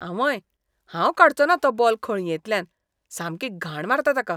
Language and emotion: Goan Konkani, disgusted